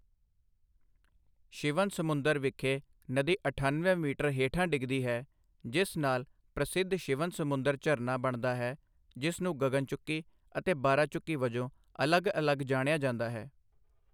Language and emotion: Punjabi, neutral